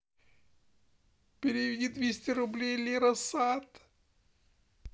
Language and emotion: Russian, sad